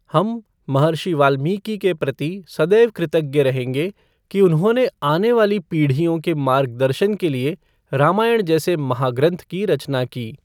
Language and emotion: Hindi, neutral